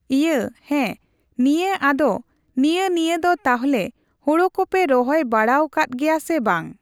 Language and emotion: Santali, neutral